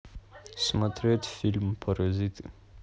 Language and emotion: Russian, neutral